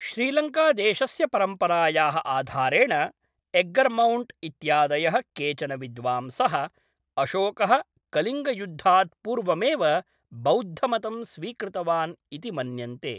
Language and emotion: Sanskrit, neutral